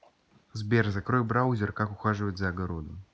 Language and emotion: Russian, neutral